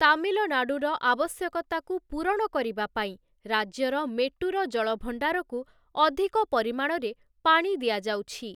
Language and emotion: Odia, neutral